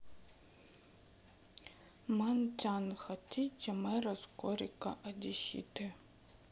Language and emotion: Russian, sad